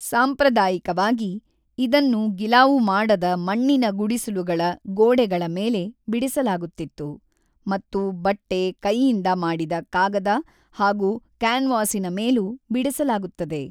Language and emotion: Kannada, neutral